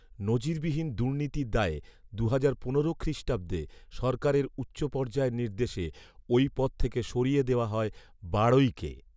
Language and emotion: Bengali, neutral